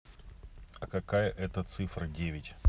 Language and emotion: Russian, neutral